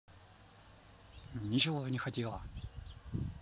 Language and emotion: Russian, angry